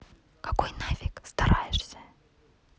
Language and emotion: Russian, neutral